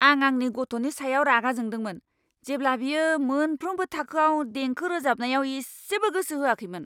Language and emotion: Bodo, angry